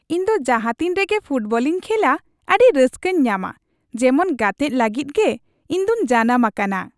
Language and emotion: Santali, happy